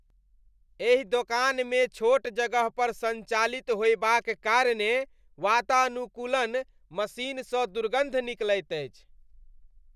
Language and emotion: Maithili, disgusted